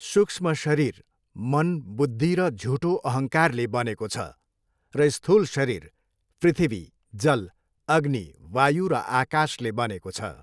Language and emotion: Nepali, neutral